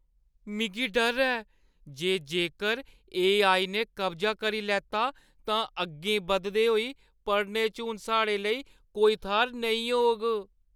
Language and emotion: Dogri, fearful